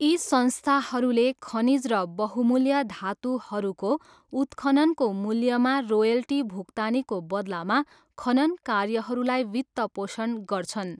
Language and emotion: Nepali, neutral